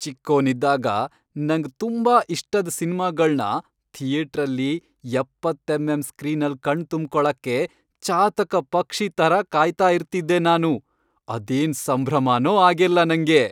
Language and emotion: Kannada, happy